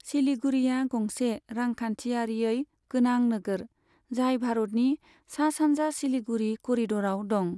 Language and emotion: Bodo, neutral